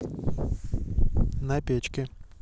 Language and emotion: Russian, neutral